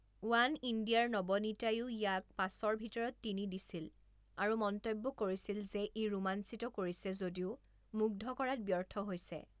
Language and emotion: Assamese, neutral